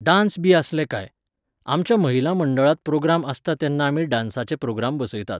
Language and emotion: Goan Konkani, neutral